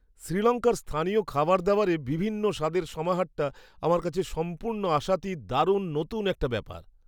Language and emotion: Bengali, surprised